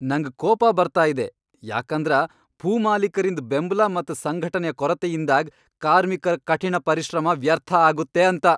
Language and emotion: Kannada, angry